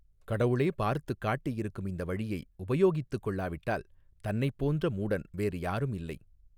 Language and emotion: Tamil, neutral